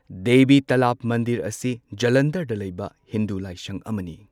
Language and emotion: Manipuri, neutral